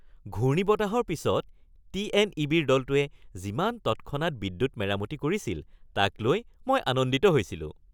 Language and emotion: Assamese, happy